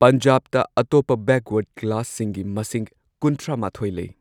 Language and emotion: Manipuri, neutral